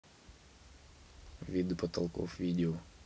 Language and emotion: Russian, neutral